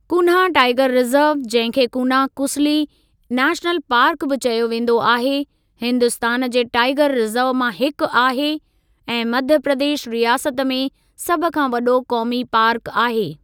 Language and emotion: Sindhi, neutral